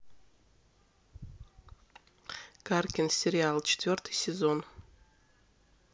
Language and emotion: Russian, neutral